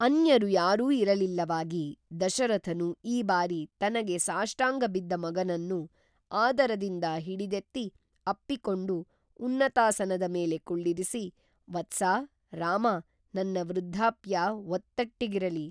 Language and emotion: Kannada, neutral